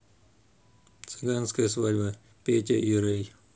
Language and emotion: Russian, neutral